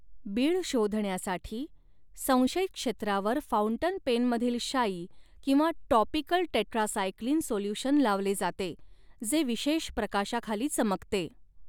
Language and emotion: Marathi, neutral